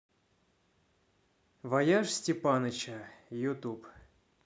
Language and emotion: Russian, neutral